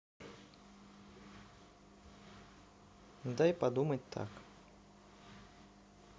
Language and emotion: Russian, neutral